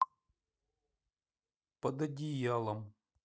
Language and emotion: Russian, neutral